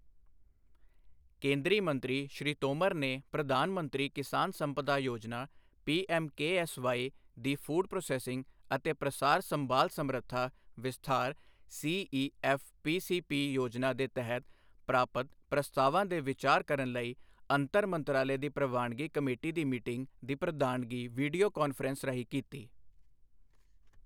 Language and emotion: Punjabi, neutral